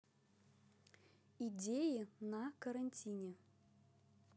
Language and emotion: Russian, neutral